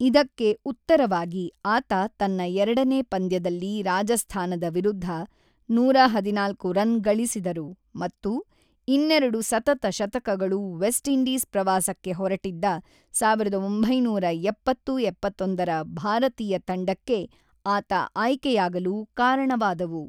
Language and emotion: Kannada, neutral